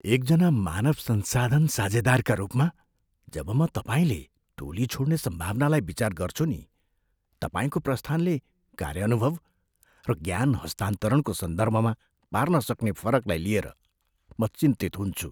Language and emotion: Nepali, fearful